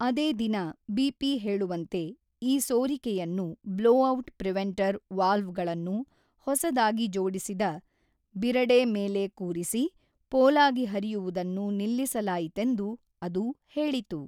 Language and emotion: Kannada, neutral